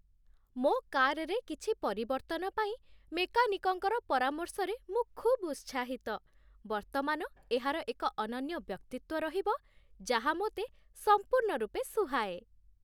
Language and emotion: Odia, happy